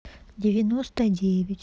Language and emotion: Russian, neutral